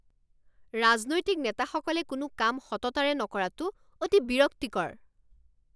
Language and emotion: Assamese, angry